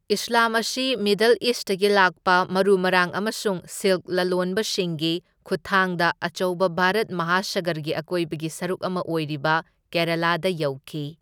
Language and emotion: Manipuri, neutral